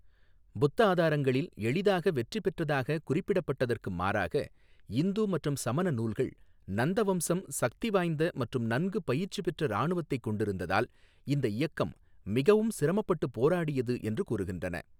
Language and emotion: Tamil, neutral